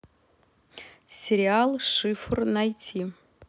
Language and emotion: Russian, neutral